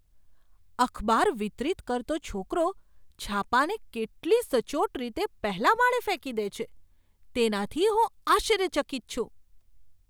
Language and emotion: Gujarati, surprised